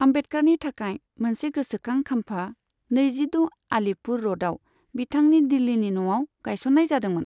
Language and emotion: Bodo, neutral